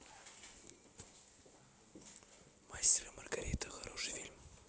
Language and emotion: Russian, neutral